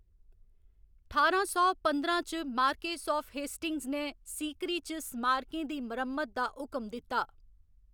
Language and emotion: Dogri, neutral